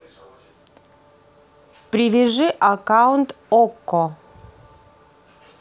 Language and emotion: Russian, neutral